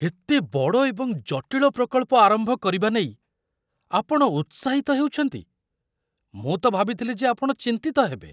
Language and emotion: Odia, surprised